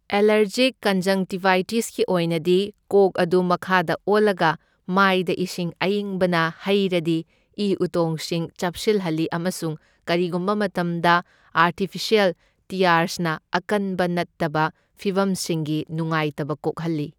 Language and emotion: Manipuri, neutral